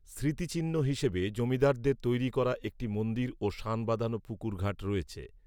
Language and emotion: Bengali, neutral